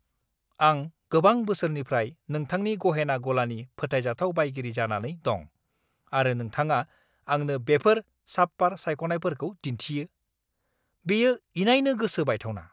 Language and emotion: Bodo, angry